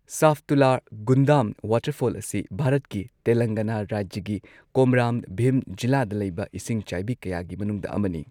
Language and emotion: Manipuri, neutral